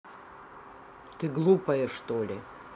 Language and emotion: Russian, angry